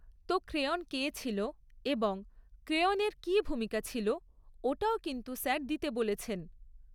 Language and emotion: Bengali, neutral